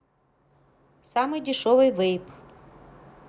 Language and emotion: Russian, neutral